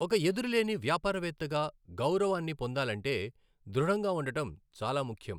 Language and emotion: Telugu, neutral